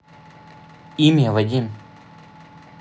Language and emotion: Russian, neutral